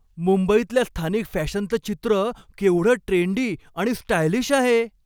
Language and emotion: Marathi, happy